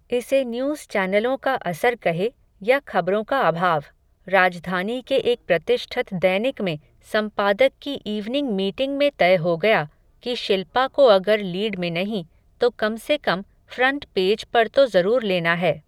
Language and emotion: Hindi, neutral